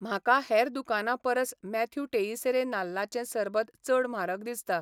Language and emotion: Goan Konkani, neutral